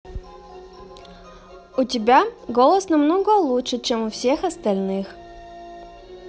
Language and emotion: Russian, positive